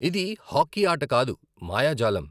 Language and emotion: Telugu, neutral